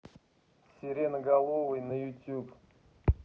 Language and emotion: Russian, neutral